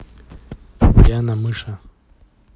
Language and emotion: Russian, neutral